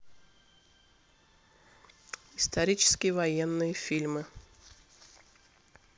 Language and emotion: Russian, neutral